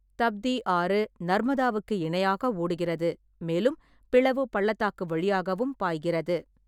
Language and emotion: Tamil, neutral